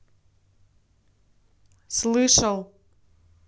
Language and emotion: Russian, angry